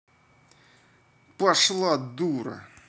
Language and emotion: Russian, angry